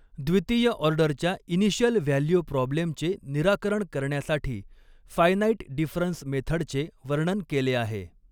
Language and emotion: Marathi, neutral